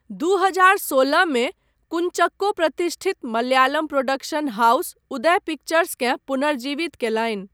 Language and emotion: Maithili, neutral